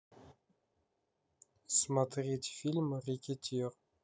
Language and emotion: Russian, neutral